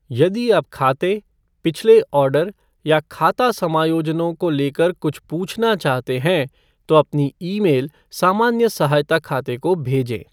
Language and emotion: Hindi, neutral